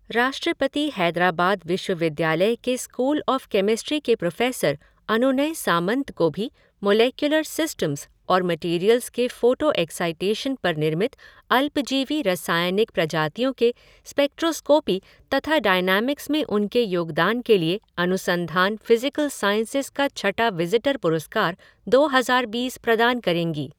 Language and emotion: Hindi, neutral